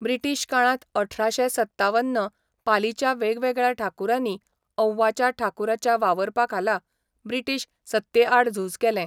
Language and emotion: Goan Konkani, neutral